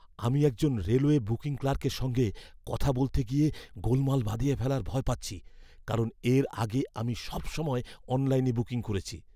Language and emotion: Bengali, fearful